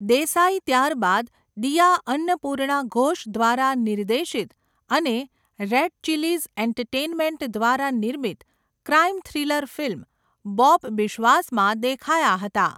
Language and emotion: Gujarati, neutral